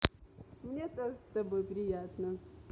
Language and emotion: Russian, positive